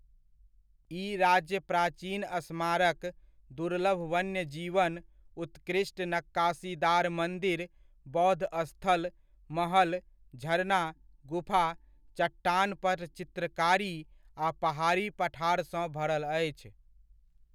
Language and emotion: Maithili, neutral